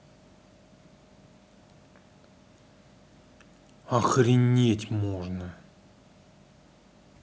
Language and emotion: Russian, angry